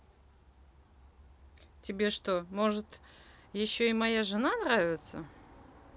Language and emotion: Russian, angry